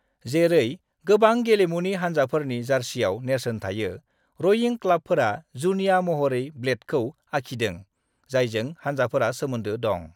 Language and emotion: Bodo, neutral